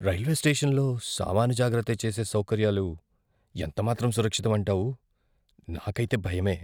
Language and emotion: Telugu, fearful